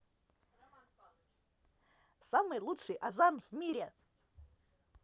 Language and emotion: Russian, positive